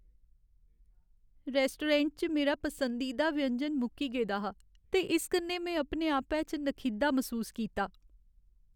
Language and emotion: Dogri, sad